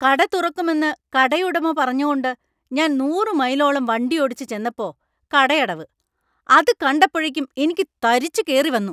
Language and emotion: Malayalam, angry